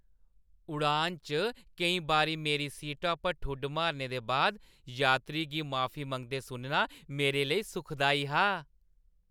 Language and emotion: Dogri, happy